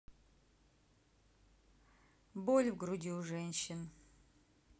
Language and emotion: Russian, neutral